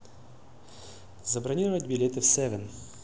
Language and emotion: Russian, neutral